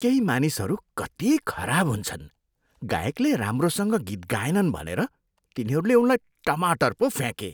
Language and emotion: Nepali, disgusted